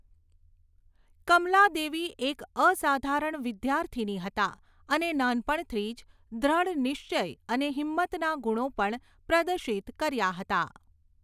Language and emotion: Gujarati, neutral